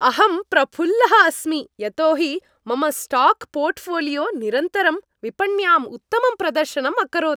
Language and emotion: Sanskrit, happy